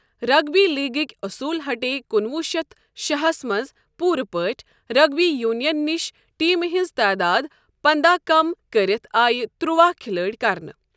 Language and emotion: Kashmiri, neutral